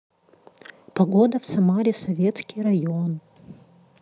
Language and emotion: Russian, neutral